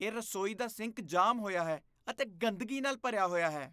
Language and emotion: Punjabi, disgusted